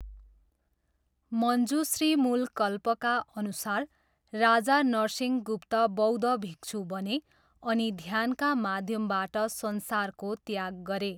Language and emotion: Nepali, neutral